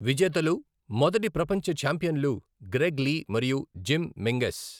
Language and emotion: Telugu, neutral